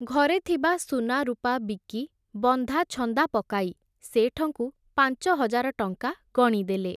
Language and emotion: Odia, neutral